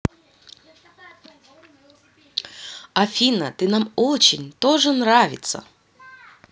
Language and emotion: Russian, positive